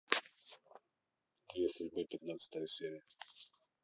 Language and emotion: Russian, neutral